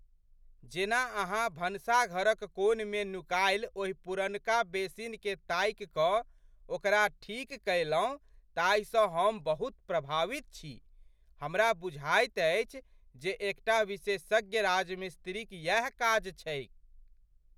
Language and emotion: Maithili, surprised